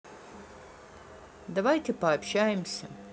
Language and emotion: Russian, neutral